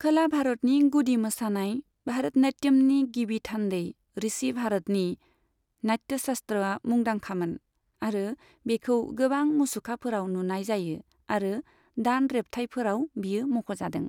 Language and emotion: Bodo, neutral